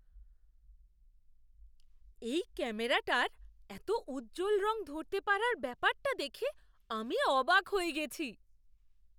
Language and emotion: Bengali, surprised